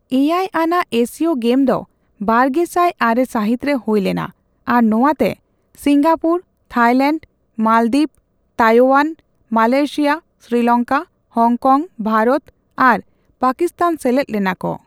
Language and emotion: Santali, neutral